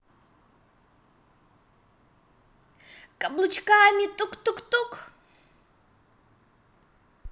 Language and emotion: Russian, positive